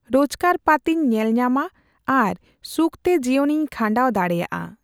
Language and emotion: Santali, neutral